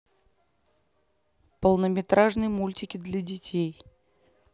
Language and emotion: Russian, neutral